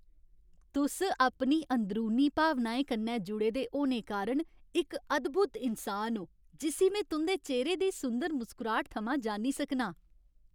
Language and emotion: Dogri, happy